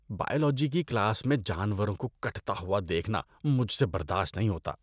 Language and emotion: Urdu, disgusted